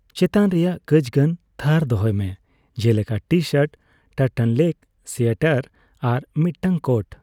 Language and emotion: Santali, neutral